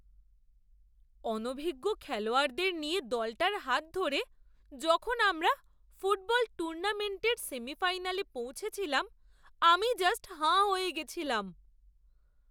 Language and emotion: Bengali, surprised